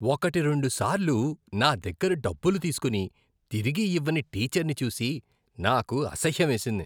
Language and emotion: Telugu, disgusted